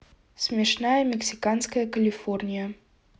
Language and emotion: Russian, neutral